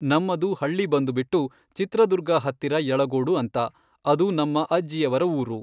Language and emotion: Kannada, neutral